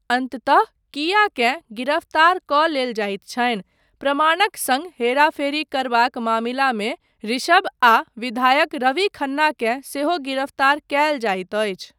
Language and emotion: Maithili, neutral